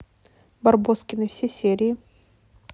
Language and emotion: Russian, neutral